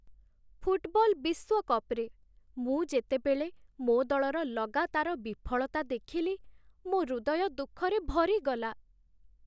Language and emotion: Odia, sad